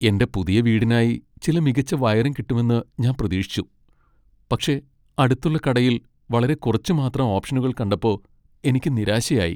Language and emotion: Malayalam, sad